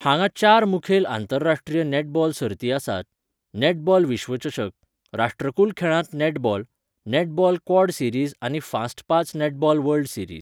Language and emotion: Goan Konkani, neutral